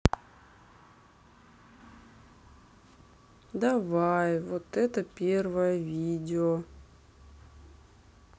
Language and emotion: Russian, sad